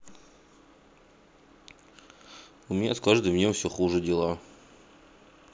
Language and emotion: Russian, sad